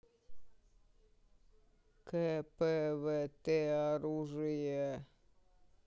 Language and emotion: Russian, neutral